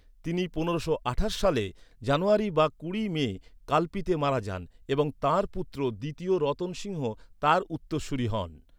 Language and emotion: Bengali, neutral